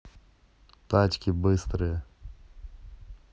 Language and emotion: Russian, neutral